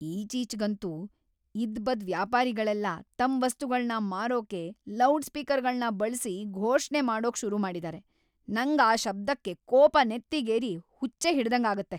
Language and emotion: Kannada, angry